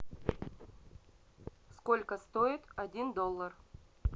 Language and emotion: Russian, neutral